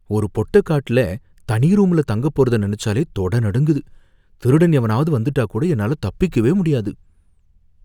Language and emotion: Tamil, fearful